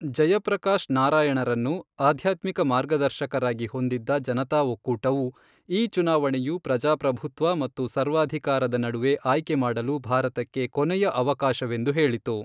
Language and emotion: Kannada, neutral